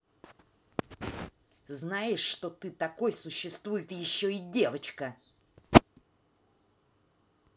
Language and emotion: Russian, angry